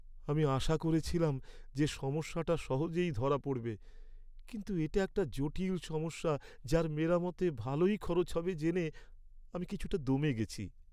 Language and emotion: Bengali, sad